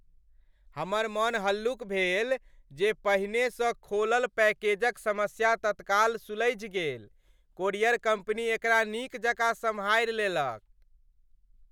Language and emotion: Maithili, happy